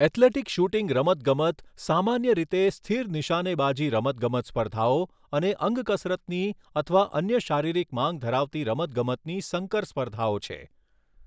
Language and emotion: Gujarati, neutral